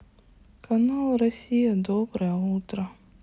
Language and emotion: Russian, sad